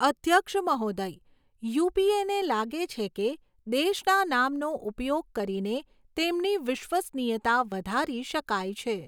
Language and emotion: Gujarati, neutral